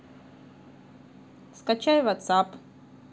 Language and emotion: Russian, neutral